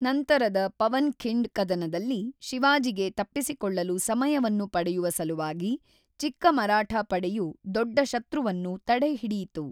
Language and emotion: Kannada, neutral